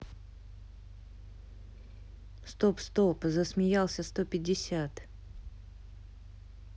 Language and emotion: Russian, neutral